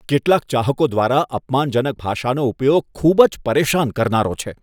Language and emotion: Gujarati, disgusted